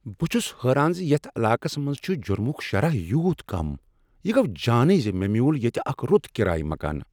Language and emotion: Kashmiri, surprised